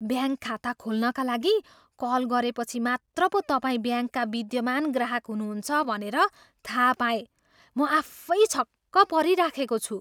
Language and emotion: Nepali, surprised